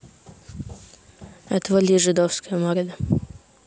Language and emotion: Russian, neutral